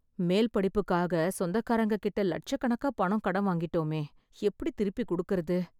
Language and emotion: Tamil, sad